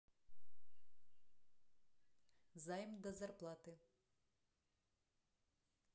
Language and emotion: Russian, neutral